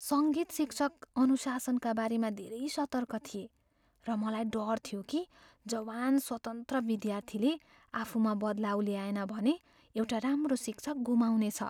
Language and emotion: Nepali, fearful